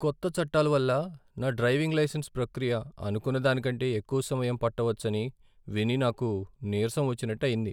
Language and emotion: Telugu, sad